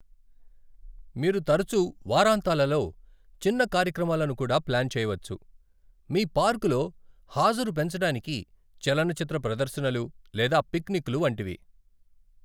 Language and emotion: Telugu, neutral